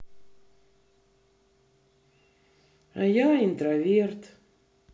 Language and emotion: Russian, sad